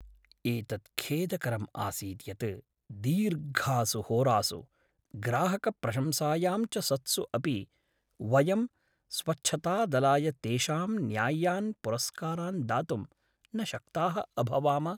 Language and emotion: Sanskrit, sad